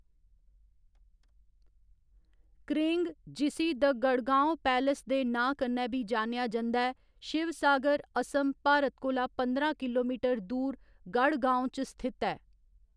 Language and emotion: Dogri, neutral